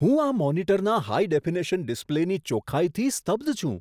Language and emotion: Gujarati, surprised